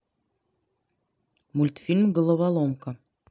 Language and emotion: Russian, neutral